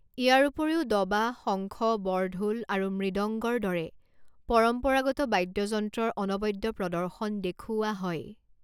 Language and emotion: Assamese, neutral